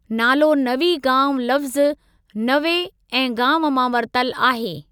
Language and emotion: Sindhi, neutral